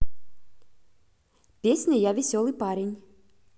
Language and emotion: Russian, positive